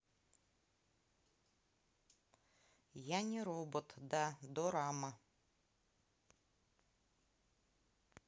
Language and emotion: Russian, neutral